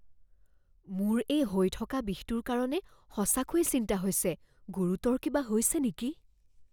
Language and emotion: Assamese, fearful